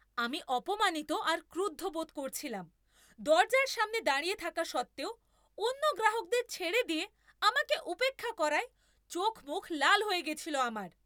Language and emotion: Bengali, angry